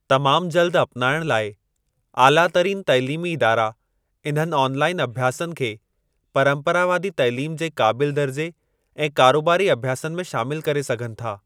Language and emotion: Sindhi, neutral